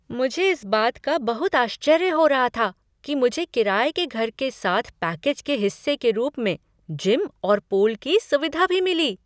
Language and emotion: Hindi, surprised